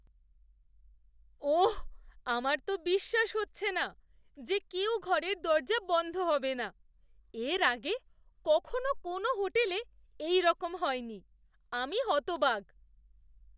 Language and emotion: Bengali, surprised